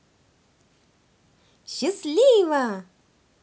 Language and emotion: Russian, positive